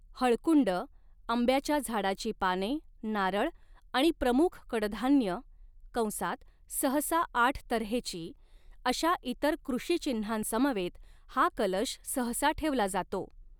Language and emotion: Marathi, neutral